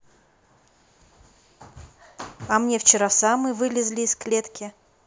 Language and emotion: Russian, neutral